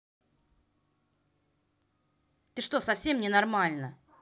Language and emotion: Russian, angry